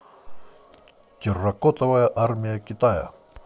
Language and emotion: Russian, positive